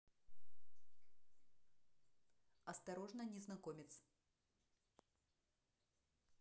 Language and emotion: Russian, neutral